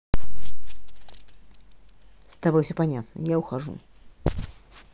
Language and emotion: Russian, angry